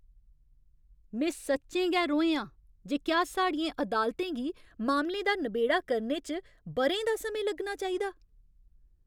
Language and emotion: Dogri, angry